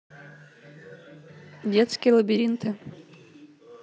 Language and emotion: Russian, neutral